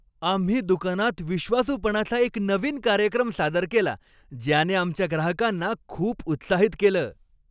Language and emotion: Marathi, happy